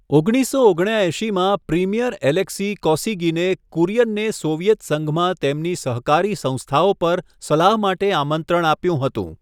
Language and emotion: Gujarati, neutral